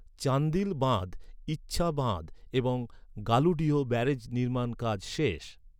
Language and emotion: Bengali, neutral